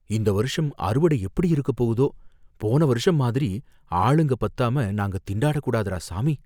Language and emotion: Tamil, fearful